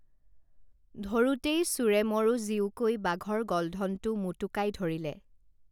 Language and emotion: Assamese, neutral